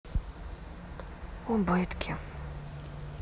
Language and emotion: Russian, sad